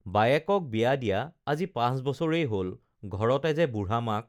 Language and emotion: Assamese, neutral